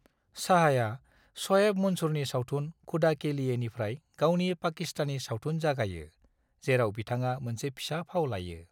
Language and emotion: Bodo, neutral